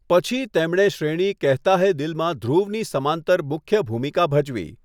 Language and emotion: Gujarati, neutral